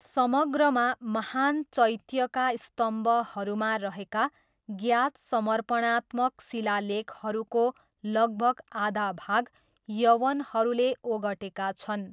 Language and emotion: Nepali, neutral